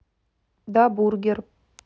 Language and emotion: Russian, neutral